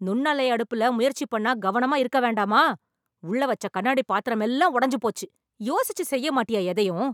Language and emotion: Tamil, angry